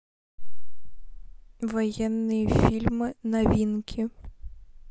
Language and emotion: Russian, neutral